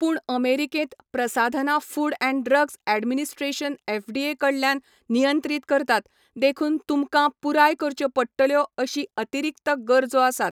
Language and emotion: Goan Konkani, neutral